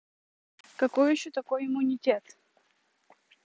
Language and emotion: Russian, neutral